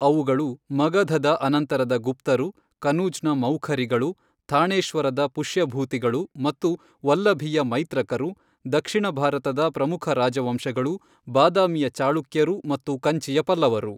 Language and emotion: Kannada, neutral